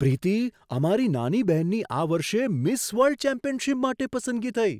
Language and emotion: Gujarati, surprised